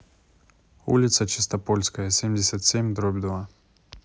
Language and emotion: Russian, neutral